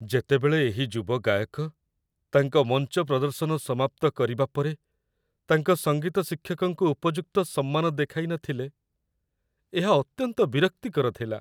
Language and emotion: Odia, sad